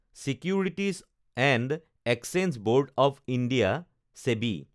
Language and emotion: Assamese, neutral